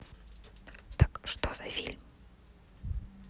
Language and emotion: Russian, neutral